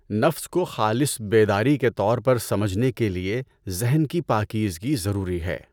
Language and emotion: Urdu, neutral